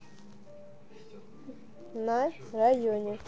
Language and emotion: Russian, neutral